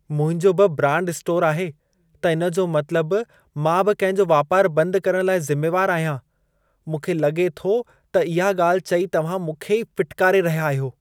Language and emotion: Sindhi, disgusted